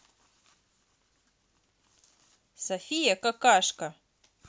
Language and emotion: Russian, neutral